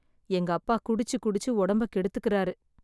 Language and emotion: Tamil, sad